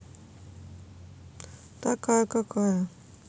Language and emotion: Russian, neutral